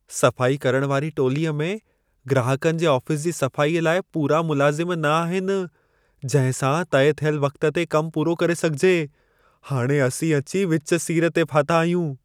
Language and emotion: Sindhi, fearful